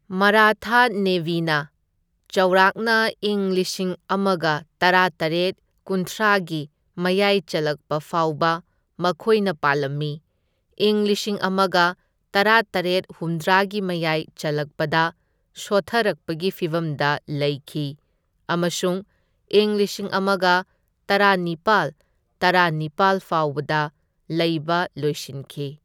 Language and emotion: Manipuri, neutral